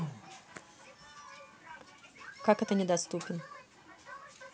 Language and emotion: Russian, neutral